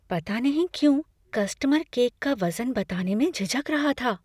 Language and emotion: Hindi, fearful